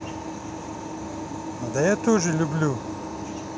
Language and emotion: Russian, neutral